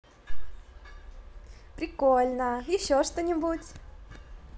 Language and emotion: Russian, positive